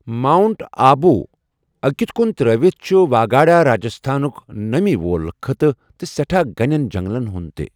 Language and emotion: Kashmiri, neutral